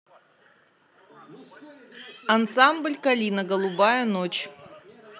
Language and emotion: Russian, neutral